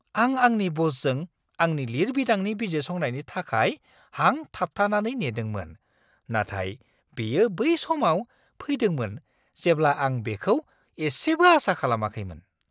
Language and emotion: Bodo, surprised